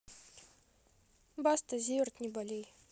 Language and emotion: Russian, neutral